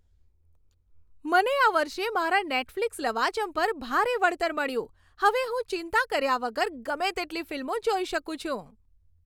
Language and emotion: Gujarati, happy